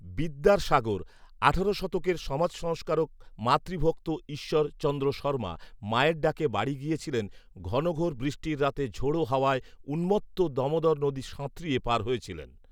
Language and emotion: Bengali, neutral